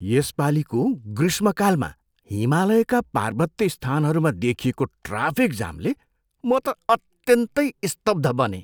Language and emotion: Nepali, surprised